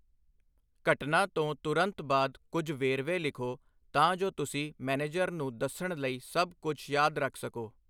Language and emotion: Punjabi, neutral